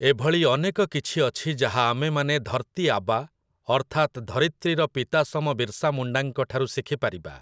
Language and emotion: Odia, neutral